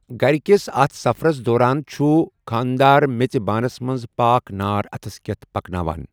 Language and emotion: Kashmiri, neutral